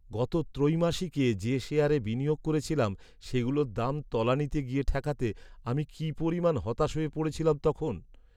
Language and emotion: Bengali, sad